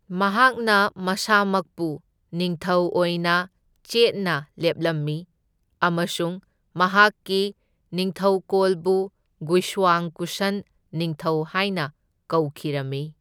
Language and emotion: Manipuri, neutral